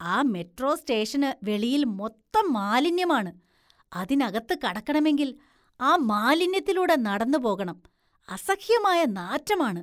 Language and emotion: Malayalam, disgusted